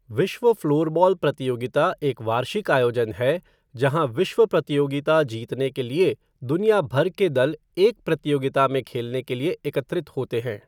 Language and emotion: Hindi, neutral